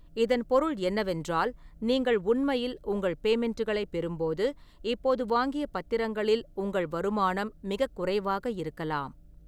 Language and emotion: Tamil, neutral